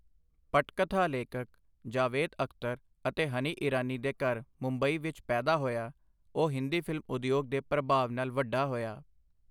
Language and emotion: Punjabi, neutral